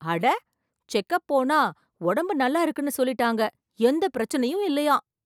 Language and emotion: Tamil, surprised